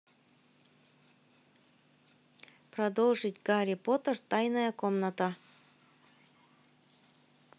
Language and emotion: Russian, neutral